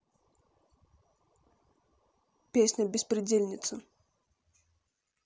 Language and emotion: Russian, neutral